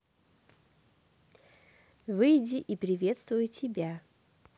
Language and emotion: Russian, positive